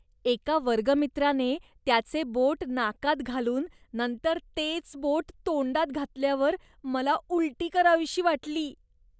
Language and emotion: Marathi, disgusted